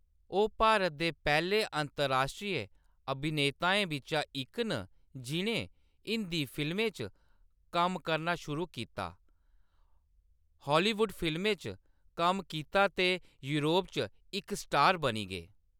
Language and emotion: Dogri, neutral